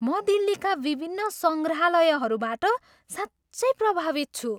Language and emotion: Nepali, surprised